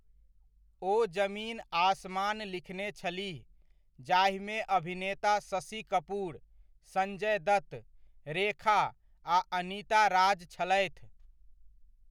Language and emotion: Maithili, neutral